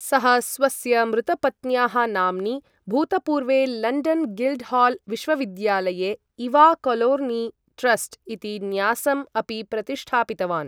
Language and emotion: Sanskrit, neutral